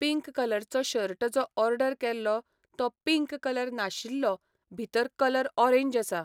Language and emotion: Goan Konkani, neutral